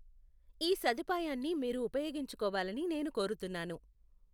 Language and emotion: Telugu, neutral